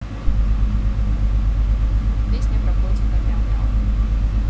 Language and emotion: Russian, neutral